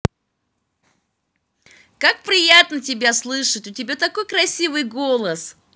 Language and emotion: Russian, positive